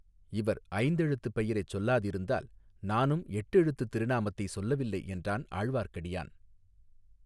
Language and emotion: Tamil, neutral